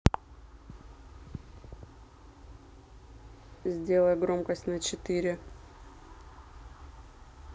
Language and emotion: Russian, angry